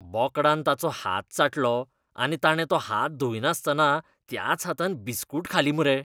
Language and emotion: Goan Konkani, disgusted